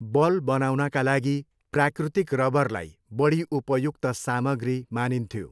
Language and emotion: Nepali, neutral